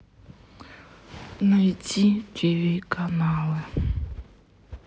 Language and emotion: Russian, sad